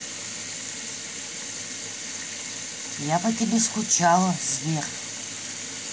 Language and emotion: Russian, neutral